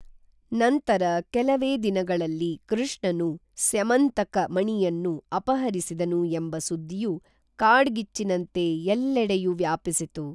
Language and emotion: Kannada, neutral